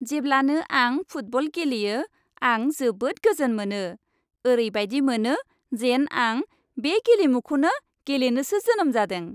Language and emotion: Bodo, happy